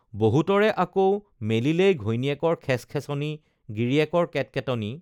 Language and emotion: Assamese, neutral